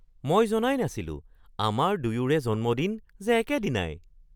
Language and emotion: Assamese, surprised